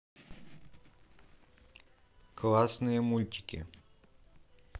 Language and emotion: Russian, neutral